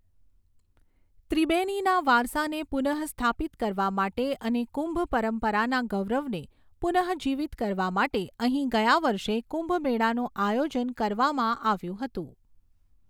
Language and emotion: Gujarati, neutral